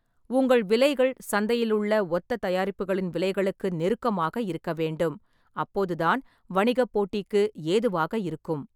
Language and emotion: Tamil, neutral